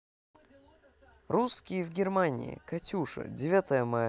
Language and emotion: Russian, positive